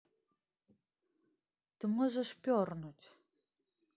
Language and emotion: Russian, neutral